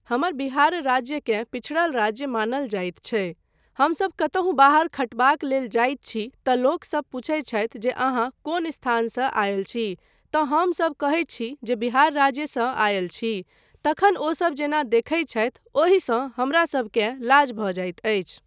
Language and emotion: Maithili, neutral